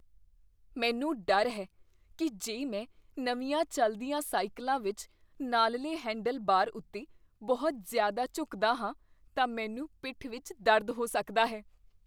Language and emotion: Punjabi, fearful